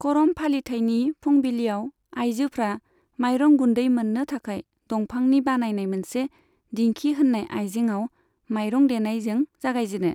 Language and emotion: Bodo, neutral